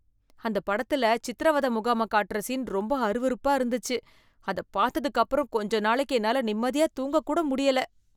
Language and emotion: Tamil, disgusted